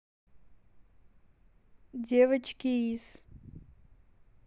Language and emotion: Russian, neutral